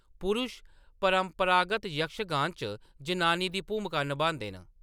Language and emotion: Dogri, neutral